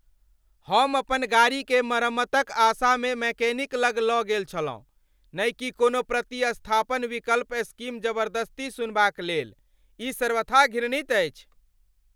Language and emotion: Maithili, angry